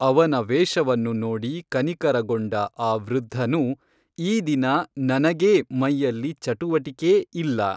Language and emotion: Kannada, neutral